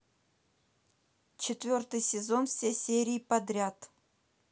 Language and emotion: Russian, neutral